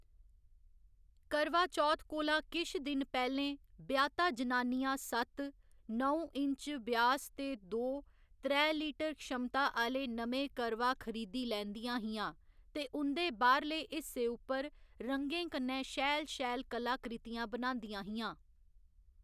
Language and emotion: Dogri, neutral